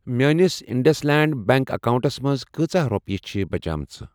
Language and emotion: Kashmiri, neutral